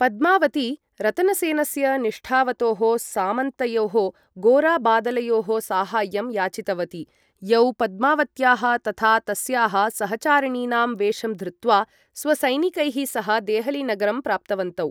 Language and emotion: Sanskrit, neutral